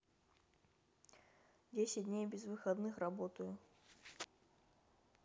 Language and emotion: Russian, neutral